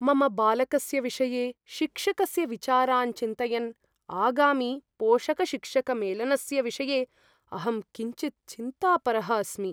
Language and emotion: Sanskrit, fearful